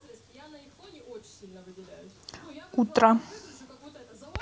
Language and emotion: Russian, neutral